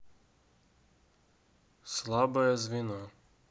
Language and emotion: Russian, neutral